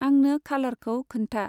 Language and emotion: Bodo, neutral